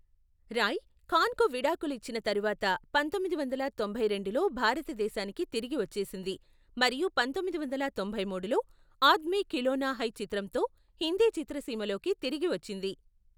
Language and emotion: Telugu, neutral